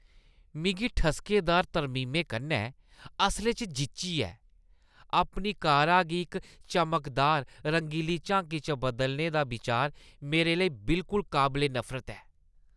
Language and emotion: Dogri, disgusted